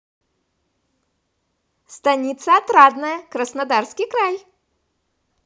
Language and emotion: Russian, positive